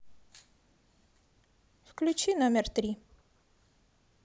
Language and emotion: Russian, neutral